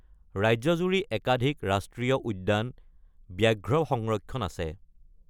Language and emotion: Assamese, neutral